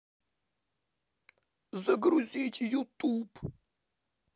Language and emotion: Russian, neutral